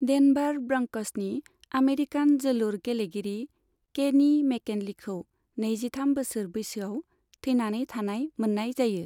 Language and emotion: Bodo, neutral